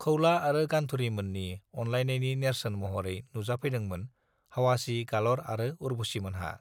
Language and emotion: Bodo, neutral